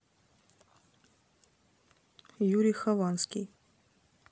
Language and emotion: Russian, neutral